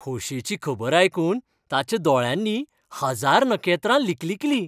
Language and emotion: Goan Konkani, happy